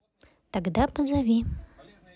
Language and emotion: Russian, neutral